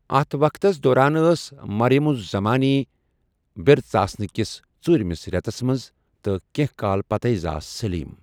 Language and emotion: Kashmiri, neutral